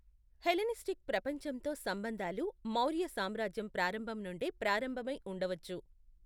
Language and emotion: Telugu, neutral